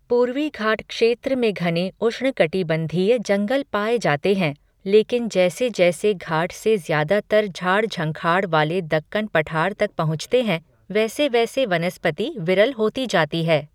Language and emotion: Hindi, neutral